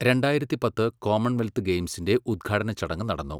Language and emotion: Malayalam, neutral